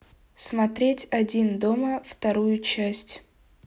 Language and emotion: Russian, neutral